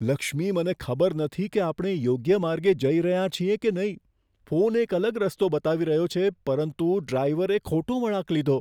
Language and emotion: Gujarati, fearful